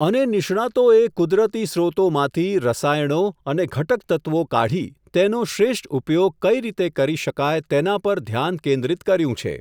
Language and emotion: Gujarati, neutral